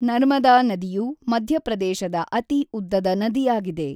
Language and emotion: Kannada, neutral